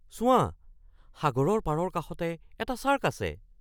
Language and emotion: Assamese, surprised